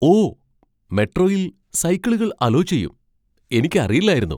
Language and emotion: Malayalam, surprised